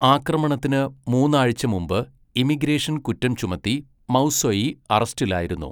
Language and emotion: Malayalam, neutral